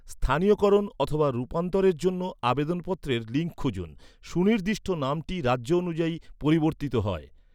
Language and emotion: Bengali, neutral